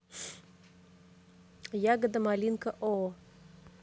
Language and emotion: Russian, neutral